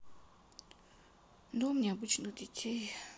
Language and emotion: Russian, sad